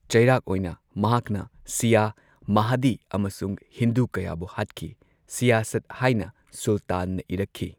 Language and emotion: Manipuri, neutral